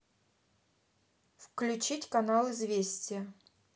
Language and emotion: Russian, neutral